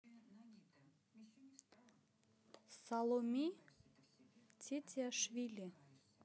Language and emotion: Russian, neutral